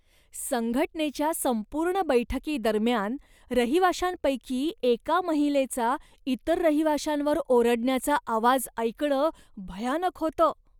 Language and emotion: Marathi, disgusted